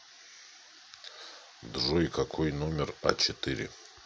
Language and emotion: Russian, neutral